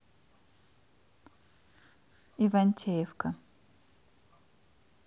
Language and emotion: Russian, neutral